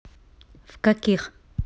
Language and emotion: Russian, neutral